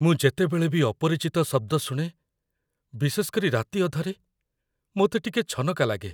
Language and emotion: Odia, fearful